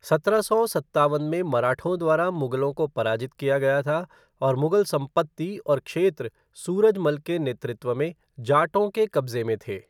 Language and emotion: Hindi, neutral